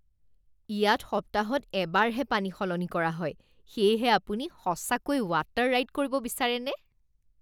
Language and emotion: Assamese, disgusted